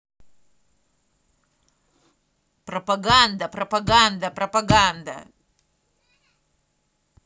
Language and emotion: Russian, angry